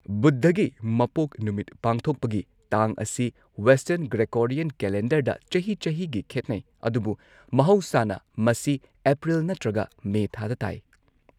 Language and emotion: Manipuri, neutral